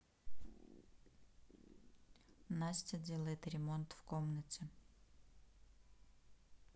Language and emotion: Russian, neutral